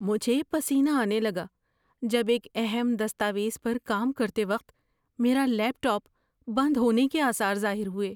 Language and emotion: Urdu, fearful